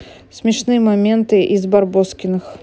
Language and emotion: Russian, neutral